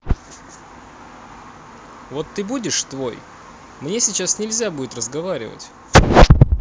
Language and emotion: Russian, neutral